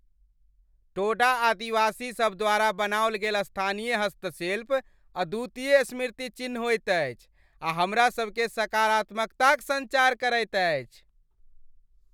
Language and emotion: Maithili, happy